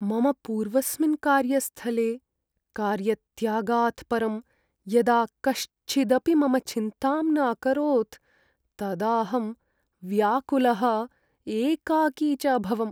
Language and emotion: Sanskrit, sad